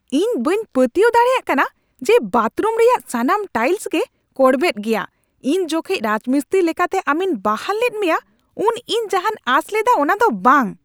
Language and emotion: Santali, angry